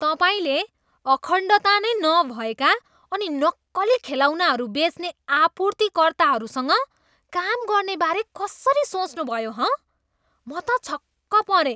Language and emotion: Nepali, disgusted